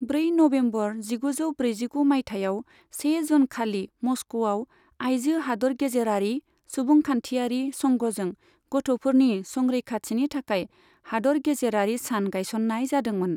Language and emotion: Bodo, neutral